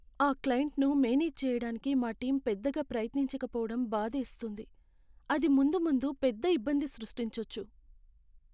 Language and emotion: Telugu, sad